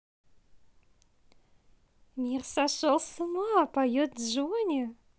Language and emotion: Russian, positive